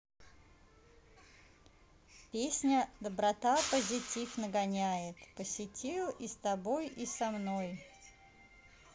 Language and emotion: Russian, neutral